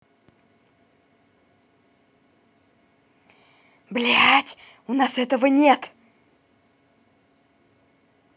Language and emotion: Russian, angry